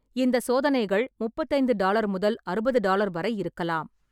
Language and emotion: Tamil, neutral